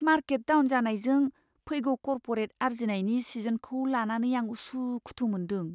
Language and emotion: Bodo, fearful